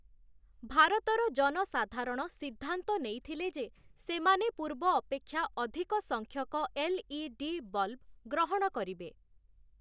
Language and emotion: Odia, neutral